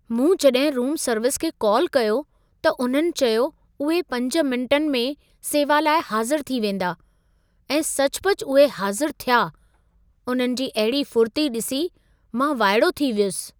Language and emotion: Sindhi, surprised